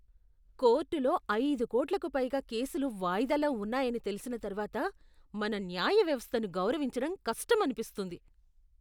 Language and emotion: Telugu, disgusted